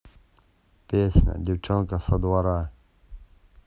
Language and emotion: Russian, neutral